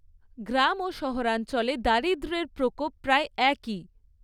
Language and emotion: Bengali, neutral